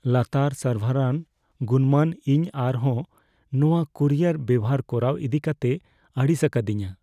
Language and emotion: Santali, fearful